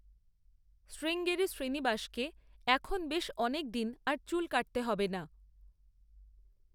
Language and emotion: Bengali, neutral